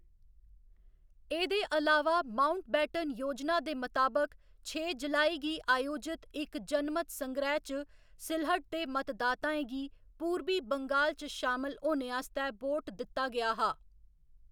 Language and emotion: Dogri, neutral